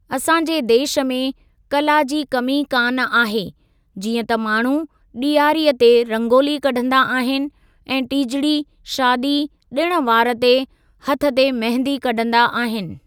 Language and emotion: Sindhi, neutral